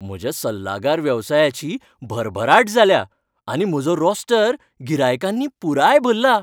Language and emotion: Goan Konkani, happy